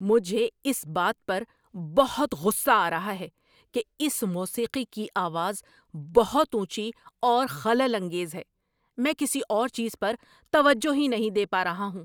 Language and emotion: Urdu, angry